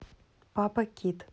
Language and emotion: Russian, neutral